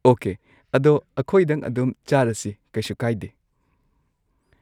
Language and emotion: Manipuri, neutral